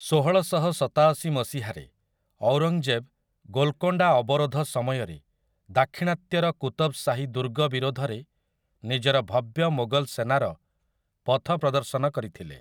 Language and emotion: Odia, neutral